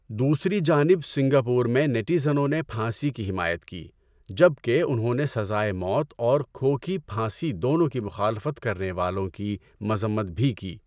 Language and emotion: Urdu, neutral